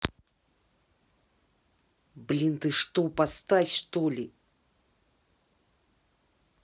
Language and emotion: Russian, angry